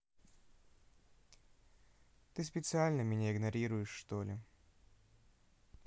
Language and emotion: Russian, sad